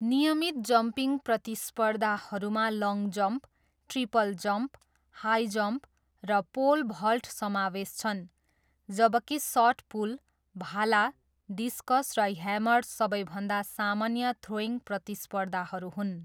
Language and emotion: Nepali, neutral